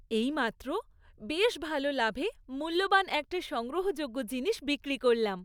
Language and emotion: Bengali, happy